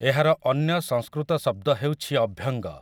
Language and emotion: Odia, neutral